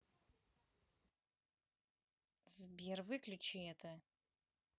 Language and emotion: Russian, angry